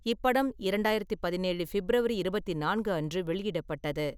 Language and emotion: Tamil, neutral